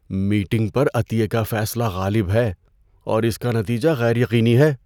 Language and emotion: Urdu, fearful